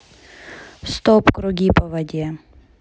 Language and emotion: Russian, neutral